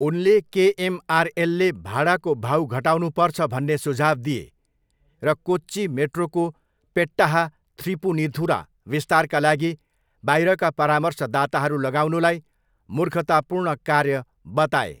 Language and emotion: Nepali, neutral